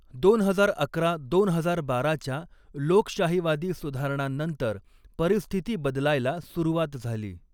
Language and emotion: Marathi, neutral